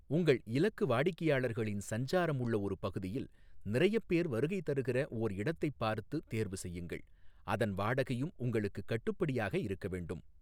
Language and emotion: Tamil, neutral